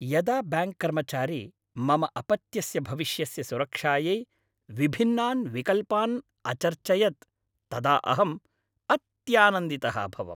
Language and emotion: Sanskrit, happy